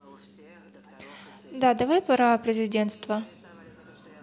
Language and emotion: Russian, neutral